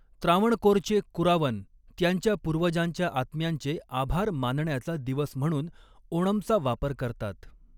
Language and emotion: Marathi, neutral